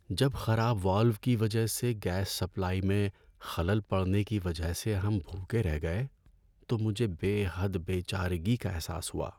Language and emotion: Urdu, sad